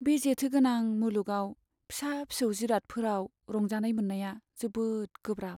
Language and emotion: Bodo, sad